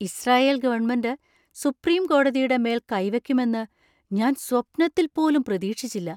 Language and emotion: Malayalam, surprised